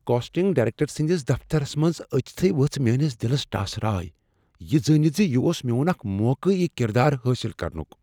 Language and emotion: Kashmiri, fearful